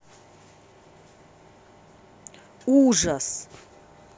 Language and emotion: Russian, angry